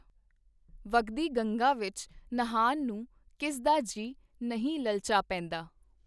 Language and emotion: Punjabi, neutral